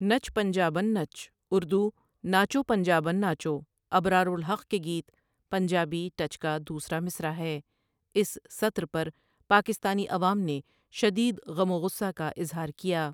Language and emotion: Urdu, neutral